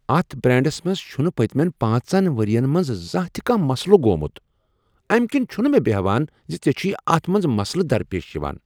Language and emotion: Kashmiri, surprised